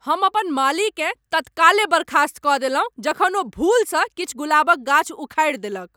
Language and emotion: Maithili, angry